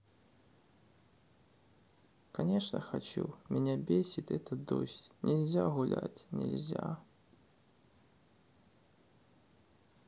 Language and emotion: Russian, sad